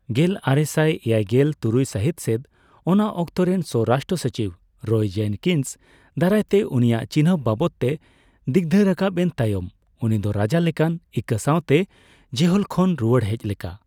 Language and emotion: Santali, neutral